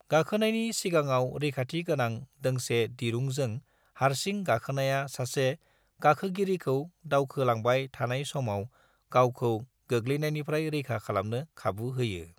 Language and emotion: Bodo, neutral